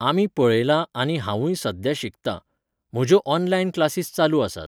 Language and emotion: Goan Konkani, neutral